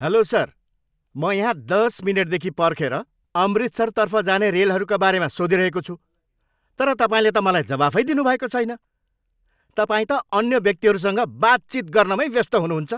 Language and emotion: Nepali, angry